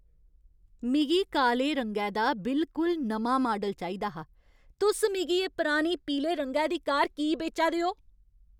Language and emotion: Dogri, angry